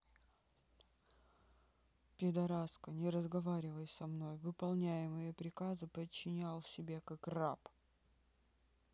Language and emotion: Russian, neutral